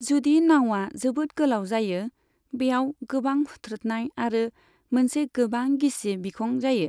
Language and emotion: Bodo, neutral